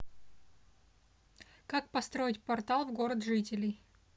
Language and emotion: Russian, neutral